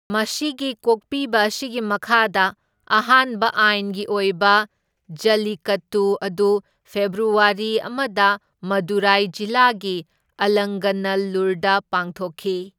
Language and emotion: Manipuri, neutral